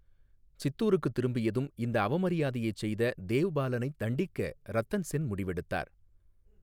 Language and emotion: Tamil, neutral